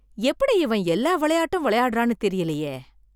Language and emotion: Tamil, surprised